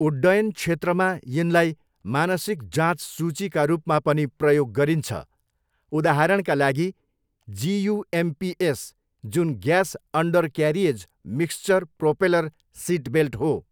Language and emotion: Nepali, neutral